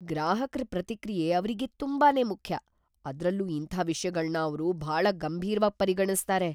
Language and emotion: Kannada, fearful